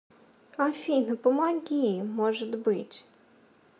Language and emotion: Russian, sad